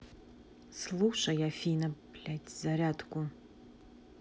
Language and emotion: Russian, neutral